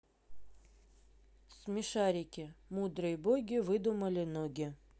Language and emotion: Russian, neutral